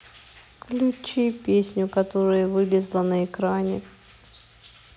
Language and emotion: Russian, sad